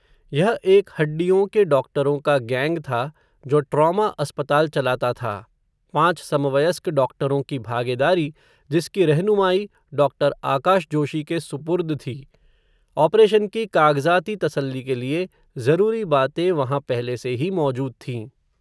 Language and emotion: Hindi, neutral